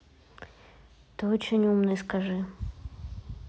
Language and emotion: Russian, neutral